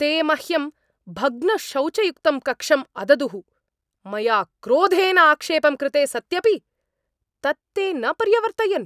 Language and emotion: Sanskrit, angry